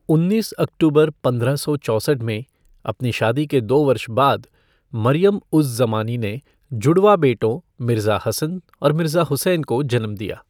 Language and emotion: Hindi, neutral